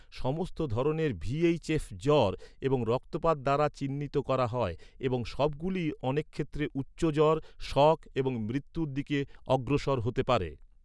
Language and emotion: Bengali, neutral